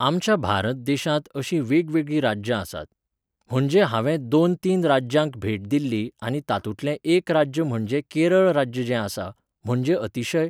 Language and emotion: Goan Konkani, neutral